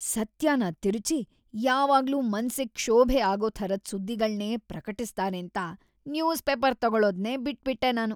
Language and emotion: Kannada, disgusted